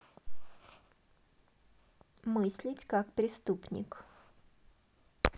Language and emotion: Russian, neutral